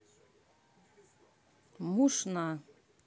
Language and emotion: Russian, neutral